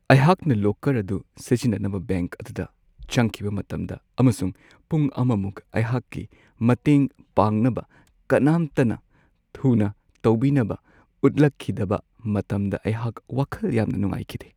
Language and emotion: Manipuri, sad